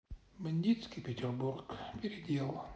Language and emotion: Russian, sad